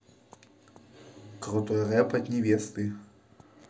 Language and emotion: Russian, positive